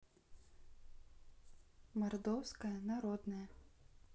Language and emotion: Russian, neutral